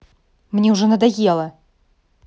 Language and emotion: Russian, angry